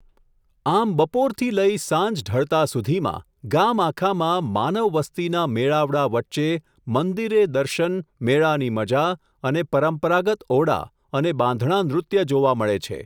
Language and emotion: Gujarati, neutral